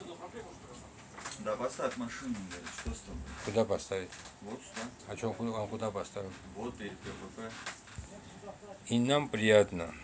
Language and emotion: Russian, neutral